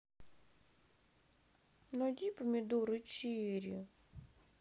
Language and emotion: Russian, sad